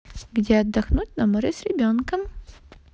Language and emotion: Russian, positive